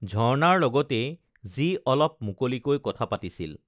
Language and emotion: Assamese, neutral